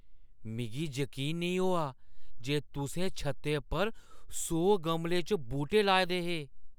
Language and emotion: Dogri, surprised